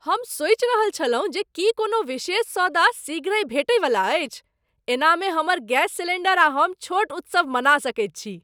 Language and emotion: Maithili, surprised